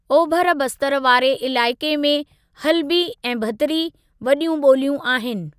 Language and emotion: Sindhi, neutral